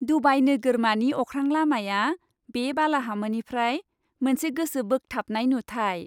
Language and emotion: Bodo, happy